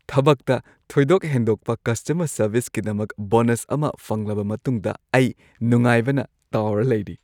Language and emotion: Manipuri, happy